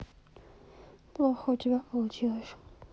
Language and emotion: Russian, sad